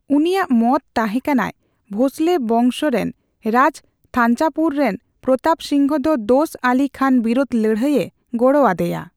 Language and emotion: Santali, neutral